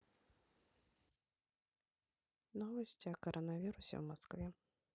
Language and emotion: Russian, neutral